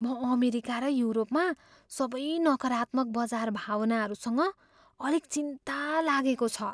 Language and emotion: Nepali, fearful